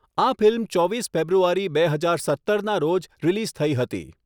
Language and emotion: Gujarati, neutral